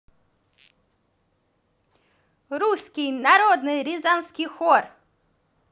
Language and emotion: Russian, positive